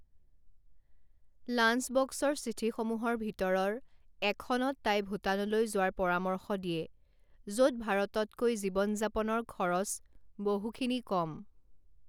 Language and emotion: Assamese, neutral